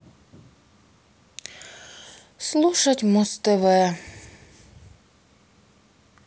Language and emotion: Russian, sad